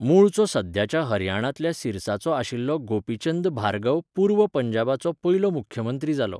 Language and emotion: Goan Konkani, neutral